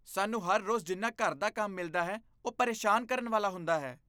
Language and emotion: Punjabi, disgusted